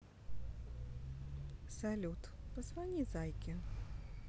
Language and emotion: Russian, positive